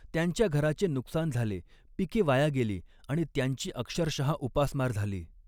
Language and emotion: Marathi, neutral